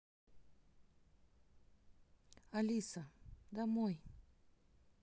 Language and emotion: Russian, neutral